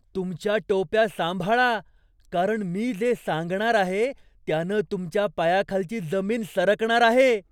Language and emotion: Marathi, surprised